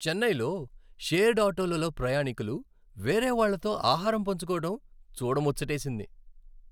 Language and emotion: Telugu, happy